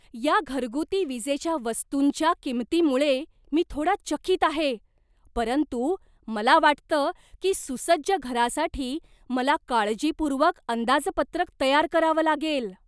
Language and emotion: Marathi, surprised